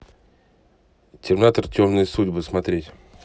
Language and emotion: Russian, neutral